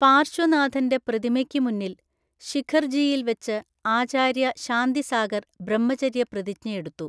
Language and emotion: Malayalam, neutral